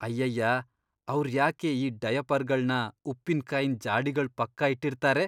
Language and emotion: Kannada, disgusted